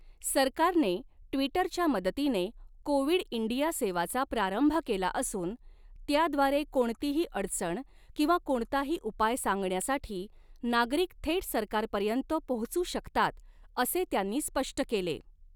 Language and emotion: Marathi, neutral